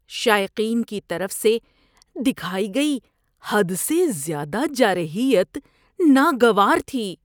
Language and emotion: Urdu, disgusted